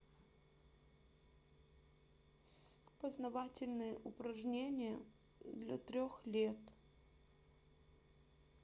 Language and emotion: Russian, sad